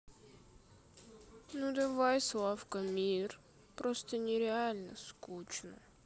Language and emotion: Russian, sad